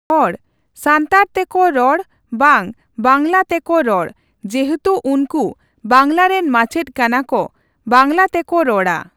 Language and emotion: Santali, neutral